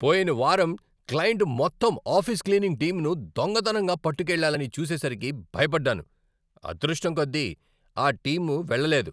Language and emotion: Telugu, angry